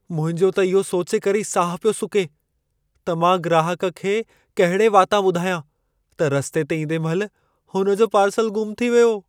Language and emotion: Sindhi, fearful